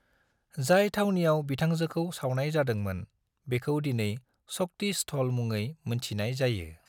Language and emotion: Bodo, neutral